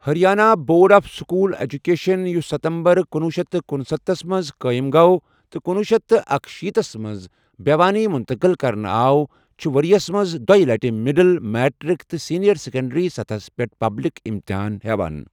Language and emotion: Kashmiri, neutral